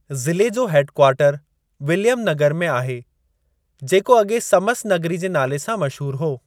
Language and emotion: Sindhi, neutral